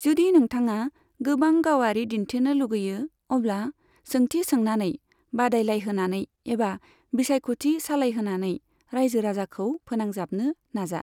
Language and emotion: Bodo, neutral